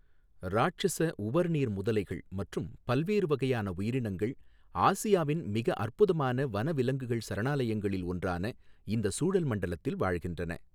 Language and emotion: Tamil, neutral